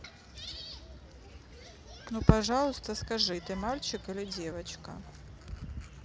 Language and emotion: Russian, neutral